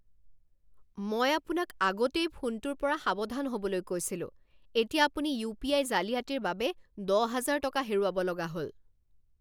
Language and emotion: Assamese, angry